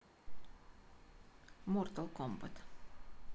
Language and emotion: Russian, neutral